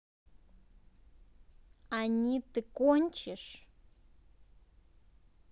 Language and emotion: Russian, angry